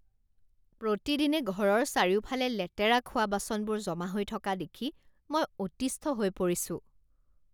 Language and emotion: Assamese, disgusted